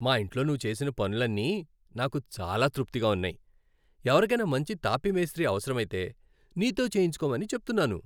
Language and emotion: Telugu, happy